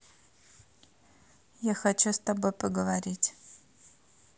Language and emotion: Russian, neutral